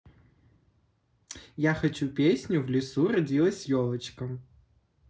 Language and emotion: Russian, positive